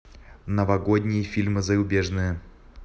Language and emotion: Russian, neutral